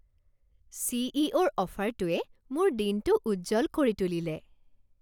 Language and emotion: Assamese, happy